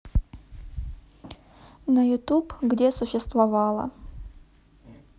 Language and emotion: Russian, neutral